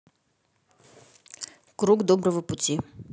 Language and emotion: Russian, neutral